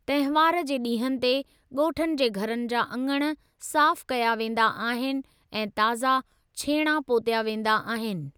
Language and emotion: Sindhi, neutral